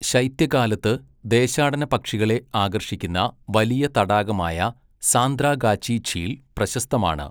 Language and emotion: Malayalam, neutral